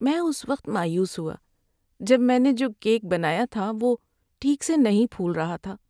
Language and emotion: Urdu, sad